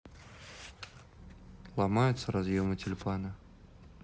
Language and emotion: Russian, neutral